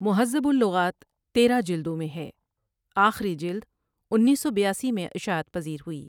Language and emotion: Urdu, neutral